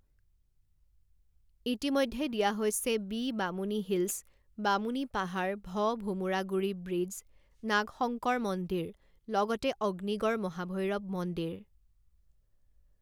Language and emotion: Assamese, neutral